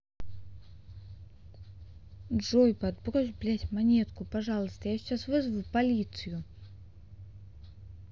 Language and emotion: Russian, neutral